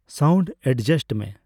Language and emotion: Santali, neutral